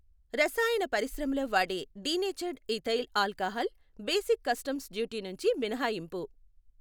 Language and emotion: Telugu, neutral